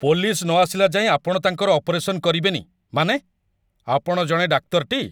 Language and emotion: Odia, angry